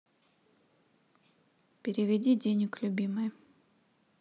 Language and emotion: Russian, neutral